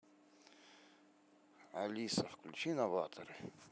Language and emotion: Russian, neutral